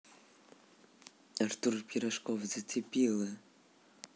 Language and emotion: Russian, neutral